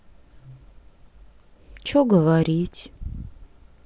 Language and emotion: Russian, sad